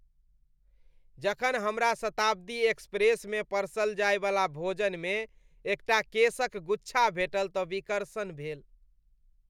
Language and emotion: Maithili, disgusted